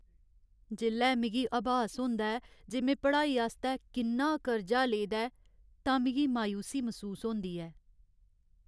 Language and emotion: Dogri, sad